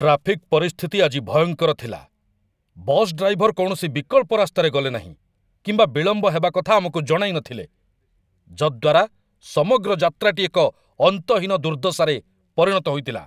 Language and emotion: Odia, angry